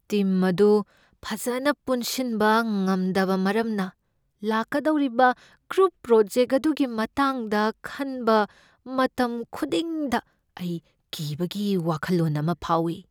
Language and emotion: Manipuri, fearful